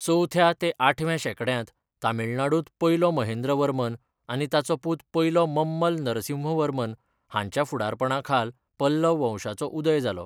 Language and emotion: Goan Konkani, neutral